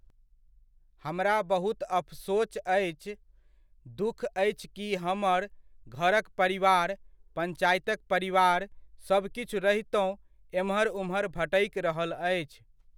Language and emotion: Maithili, neutral